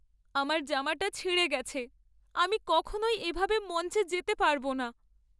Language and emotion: Bengali, sad